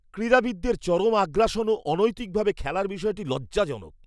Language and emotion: Bengali, disgusted